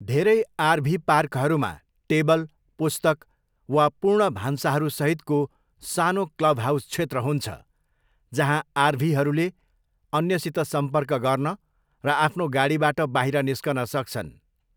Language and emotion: Nepali, neutral